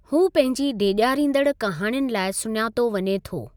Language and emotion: Sindhi, neutral